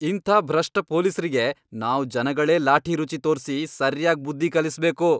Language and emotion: Kannada, angry